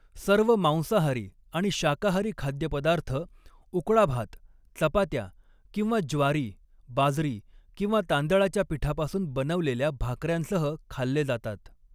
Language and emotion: Marathi, neutral